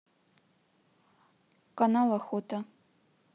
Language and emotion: Russian, neutral